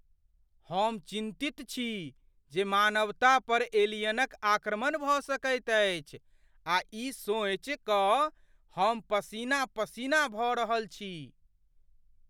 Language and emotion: Maithili, fearful